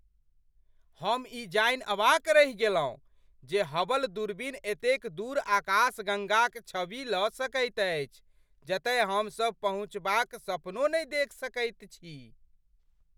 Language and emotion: Maithili, surprised